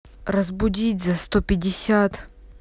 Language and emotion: Russian, angry